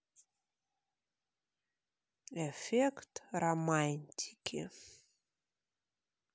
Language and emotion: Russian, neutral